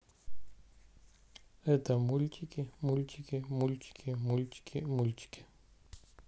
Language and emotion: Russian, neutral